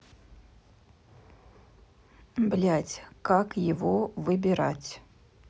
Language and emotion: Russian, neutral